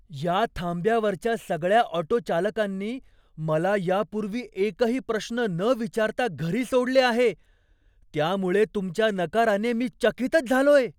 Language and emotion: Marathi, surprised